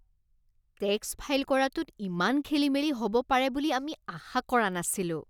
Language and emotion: Assamese, disgusted